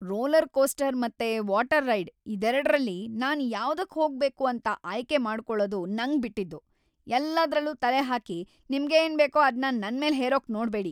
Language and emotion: Kannada, angry